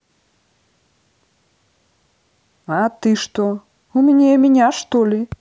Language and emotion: Russian, neutral